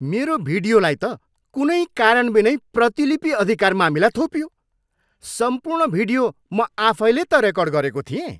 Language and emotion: Nepali, angry